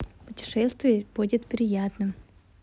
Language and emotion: Russian, positive